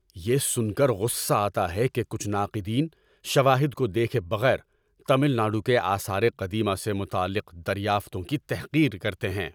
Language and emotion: Urdu, angry